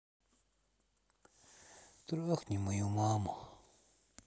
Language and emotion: Russian, sad